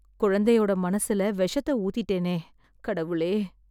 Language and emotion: Tamil, sad